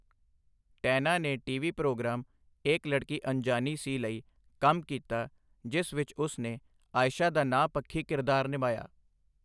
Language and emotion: Punjabi, neutral